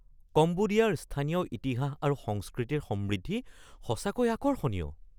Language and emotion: Assamese, surprised